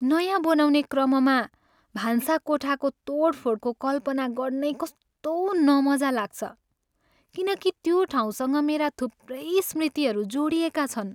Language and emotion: Nepali, sad